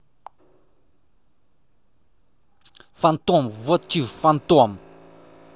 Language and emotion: Russian, angry